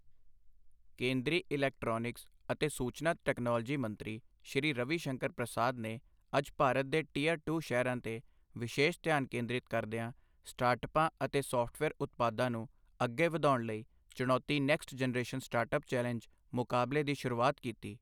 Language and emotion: Punjabi, neutral